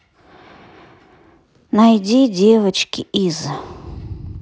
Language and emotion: Russian, sad